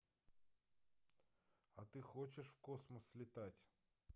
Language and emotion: Russian, neutral